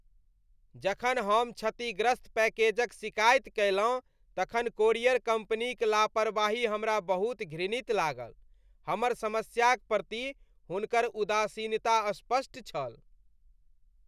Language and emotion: Maithili, disgusted